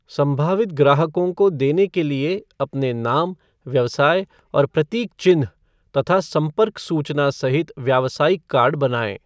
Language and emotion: Hindi, neutral